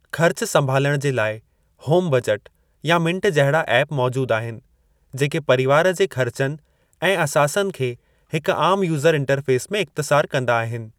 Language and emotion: Sindhi, neutral